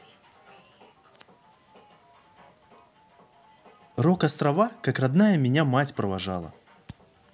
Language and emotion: Russian, positive